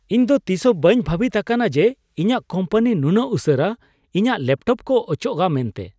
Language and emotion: Santali, surprised